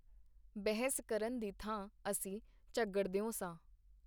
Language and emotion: Punjabi, neutral